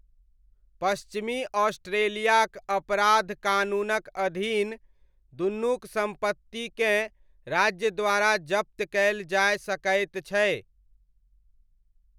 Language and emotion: Maithili, neutral